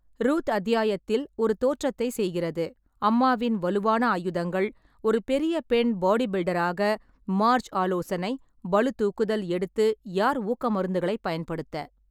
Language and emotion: Tamil, neutral